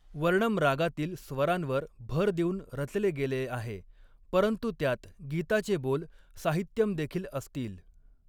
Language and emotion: Marathi, neutral